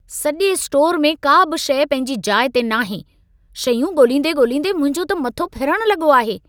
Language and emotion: Sindhi, angry